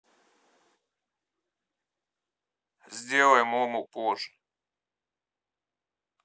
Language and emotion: Russian, neutral